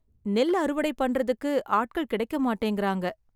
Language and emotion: Tamil, sad